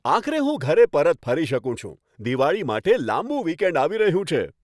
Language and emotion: Gujarati, happy